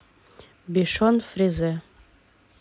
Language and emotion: Russian, neutral